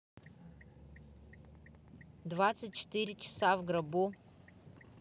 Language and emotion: Russian, neutral